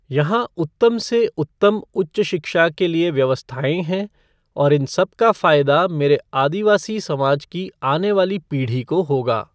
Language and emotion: Hindi, neutral